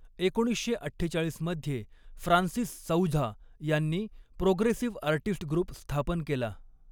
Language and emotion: Marathi, neutral